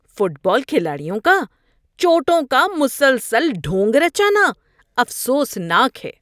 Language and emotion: Urdu, disgusted